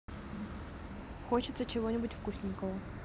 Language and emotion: Russian, neutral